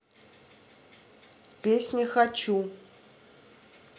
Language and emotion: Russian, neutral